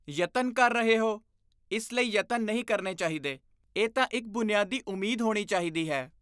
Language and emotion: Punjabi, disgusted